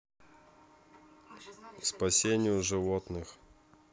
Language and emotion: Russian, neutral